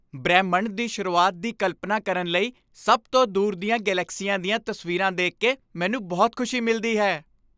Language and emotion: Punjabi, happy